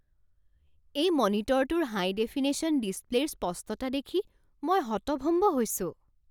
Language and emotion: Assamese, surprised